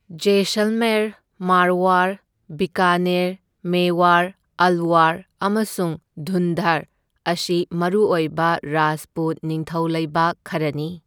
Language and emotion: Manipuri, neutral